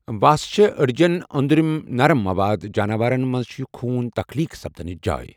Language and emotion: Kashmiri, neutral